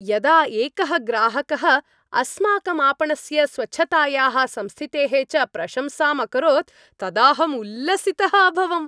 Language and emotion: Sanskrit, happy